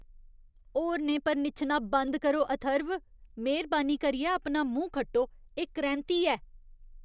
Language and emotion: Dogri, disgusted